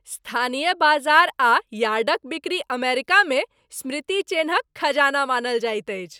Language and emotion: Maithili, happy